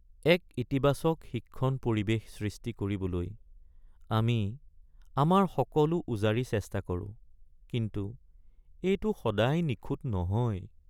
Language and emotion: Assamese, sad